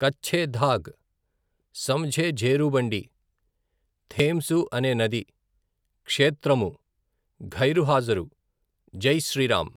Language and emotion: Telugu, neutral